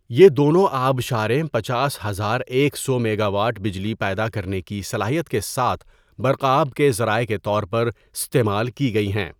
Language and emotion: Urdu, neutral